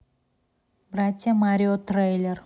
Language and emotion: Russian, neutral